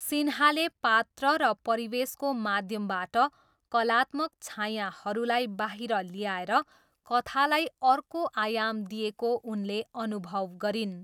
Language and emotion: Nepali, neutral